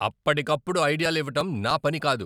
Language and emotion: Telugu, angry